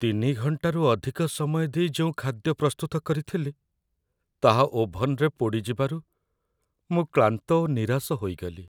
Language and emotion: Odia, sad